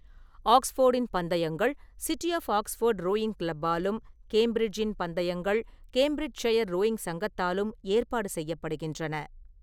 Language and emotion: Tamil, neutral